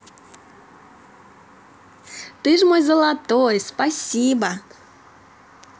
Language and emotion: Russian, positive